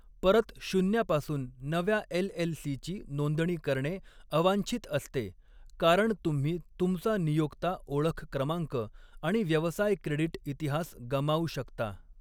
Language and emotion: Marathi, neutral